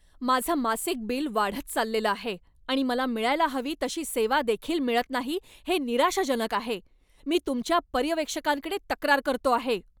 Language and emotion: Marathi, angry